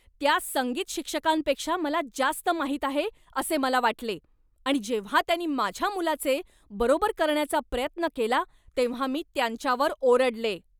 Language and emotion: Marathi, angry